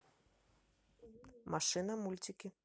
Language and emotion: Russian, neutral